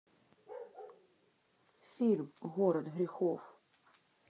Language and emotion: Russian, neutral